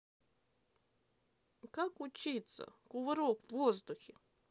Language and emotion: Russian, sad